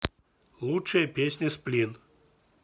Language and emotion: Russian, neutral